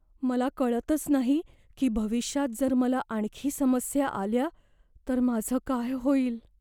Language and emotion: Marathi, fearful